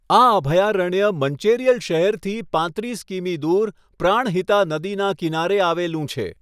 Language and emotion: Gujarati, neutral